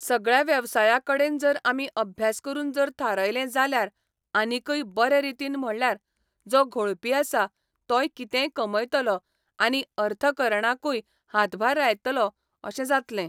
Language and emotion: Goan Konkani, neutral